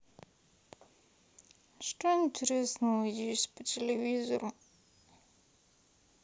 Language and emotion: Russian, sad